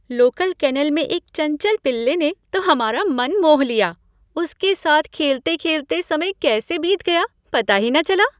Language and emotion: Hindi, happy